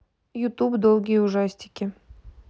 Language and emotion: Russian, neutral